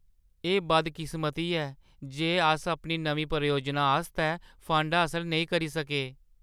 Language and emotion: Dogri, sad